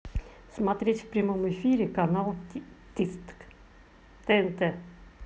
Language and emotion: Russian, neutral